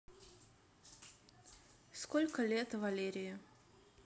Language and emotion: Russian, neutral